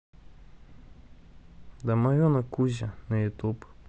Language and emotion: Russian, sad